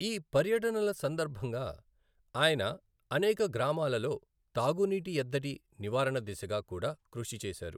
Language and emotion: Telugu, neutral